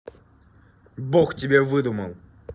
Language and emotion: Russian, angry